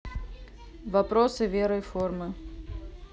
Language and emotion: Russian, neutral